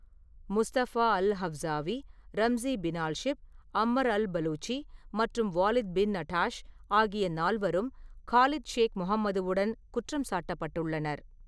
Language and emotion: Tamil, neutral